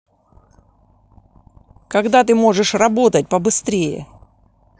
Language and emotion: Russian, angry